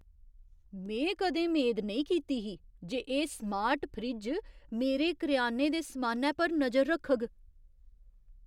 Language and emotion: Dogri, surprised